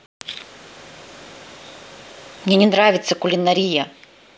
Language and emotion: Russian, angry